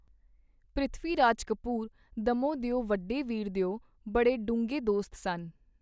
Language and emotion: Punjabi, neutral